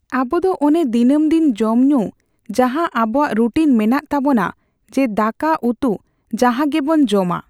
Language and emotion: Santali, neutral